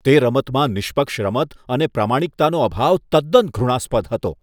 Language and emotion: Gujarati, disgusted